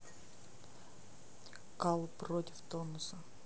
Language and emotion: Russian, neutral